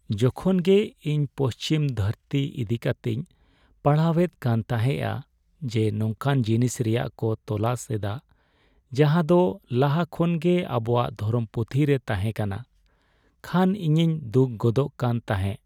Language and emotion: Santali, sad